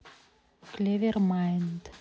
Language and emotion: Russian, neutral